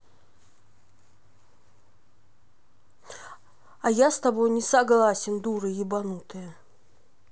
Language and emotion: Russian, angry